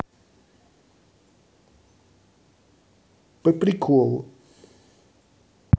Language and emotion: Russian, neutral